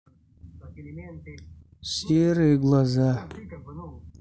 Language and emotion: Russian, sad